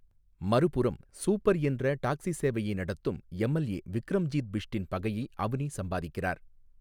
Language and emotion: Tamil, neutral